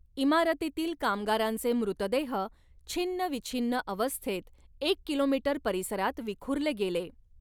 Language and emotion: Marathi, neutral